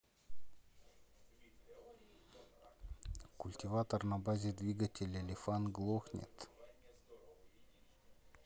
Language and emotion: Russian, neutral